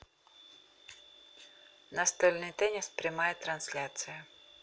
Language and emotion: Russian, neutral